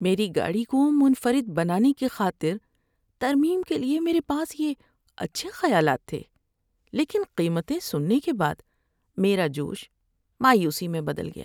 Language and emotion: Urdu, sad